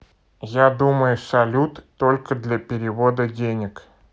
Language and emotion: Russian, neutral